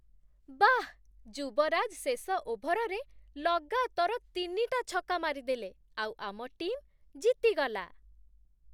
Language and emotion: Odia, surprised